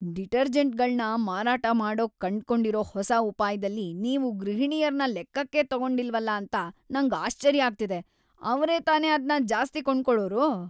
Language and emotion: Kannada, disgusted